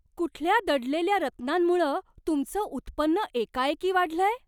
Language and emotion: Marathi, surprised